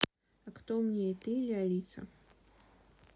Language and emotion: Russian, neutral